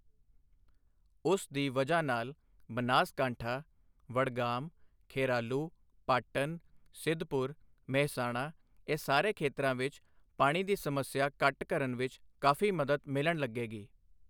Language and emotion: Punjabi, neutral